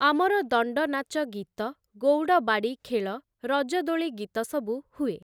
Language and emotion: Odia, neutral